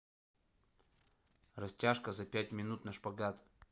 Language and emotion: Russian, neutral